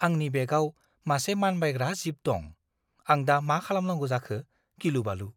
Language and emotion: Bodo, fearful